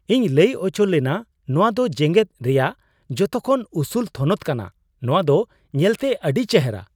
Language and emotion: Santali, surprised